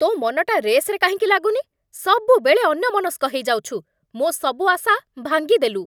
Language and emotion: Odia, angry